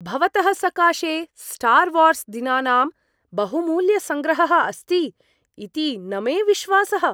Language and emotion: Sanskrit, surprised